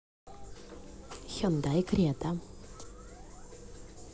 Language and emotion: Russian, neutral